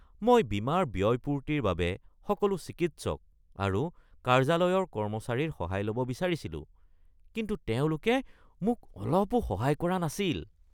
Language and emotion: Assamese, disgusted